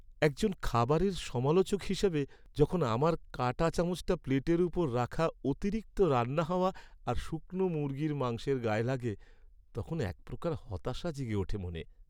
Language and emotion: Bengali, sad